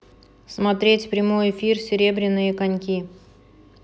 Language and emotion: Russian, neutral